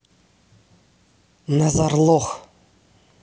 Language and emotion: Russian, neutral